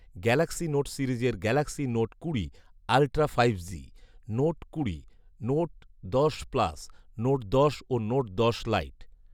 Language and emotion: Bengali, neutral